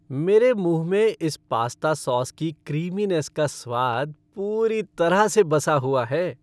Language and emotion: Hindi, happy